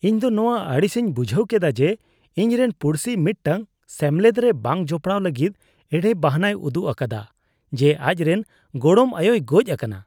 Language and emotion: Santali, disgusted